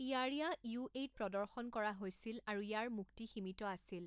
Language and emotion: Assamese, neutral